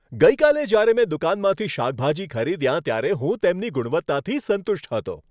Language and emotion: Gujarati, happy